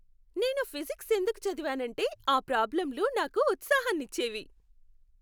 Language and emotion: Telugu, happy